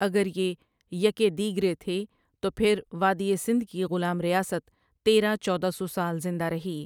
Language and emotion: Urdu, neutral